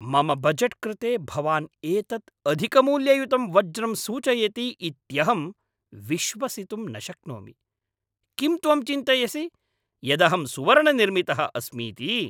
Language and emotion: Sanskrit, angry